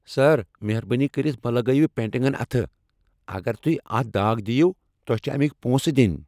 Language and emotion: Kashmiri, angry